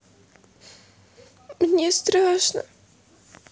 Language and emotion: Russian, sad